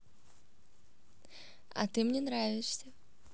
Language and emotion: Russian, positive